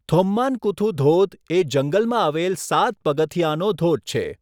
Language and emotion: Gujarati, neutral